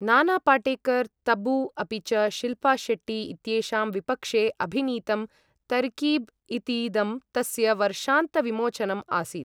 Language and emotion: Sanskrit, neutral